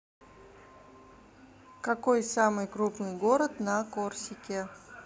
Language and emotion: Russian, neutral